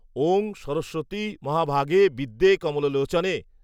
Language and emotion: Bengali, neutral